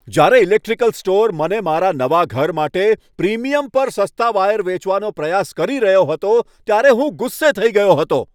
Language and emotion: Gujarati, angry